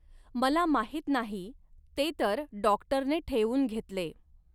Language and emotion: Marathi, neutral